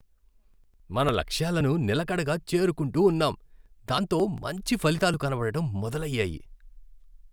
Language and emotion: Telugu, happy